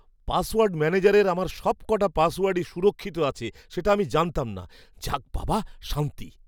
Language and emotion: Bengali, surprised